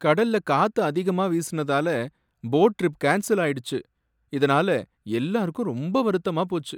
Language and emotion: Tamil, sad